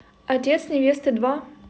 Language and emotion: Russian, neutral